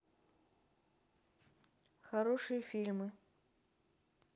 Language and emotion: Russian, neutral